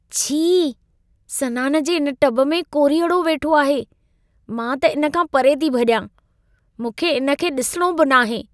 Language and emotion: Sindhi, disgusted